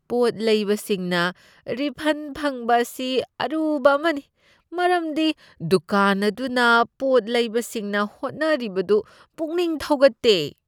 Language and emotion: Manipuri, disgusted